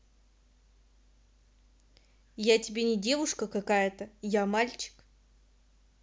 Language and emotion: Russian, angry